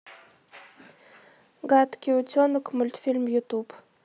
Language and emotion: Russian, neutral